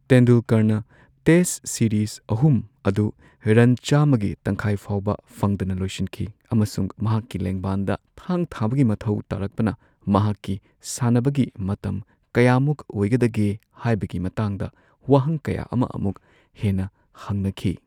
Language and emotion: Manipuri, neutral